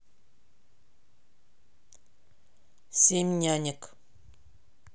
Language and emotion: Russian, neutral